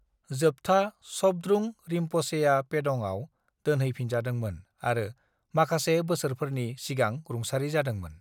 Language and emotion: Bodo, neutral